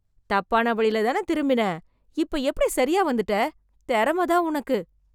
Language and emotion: Tamil, surprised